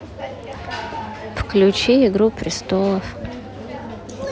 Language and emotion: Russian, neutral